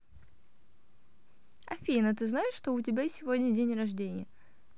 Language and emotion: Russian, positive